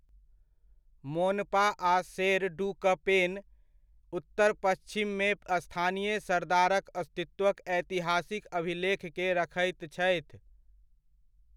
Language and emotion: Maithili, neutral